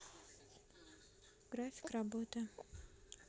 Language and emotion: Russian, neutral